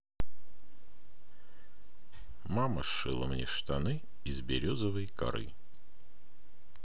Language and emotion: Russian, neutral